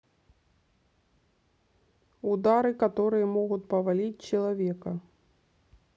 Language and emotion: Russian, neutral